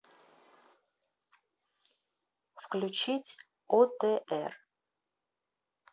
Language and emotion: Russian, neutral